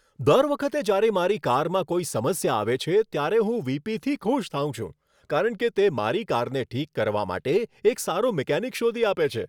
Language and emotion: Gujarati, happy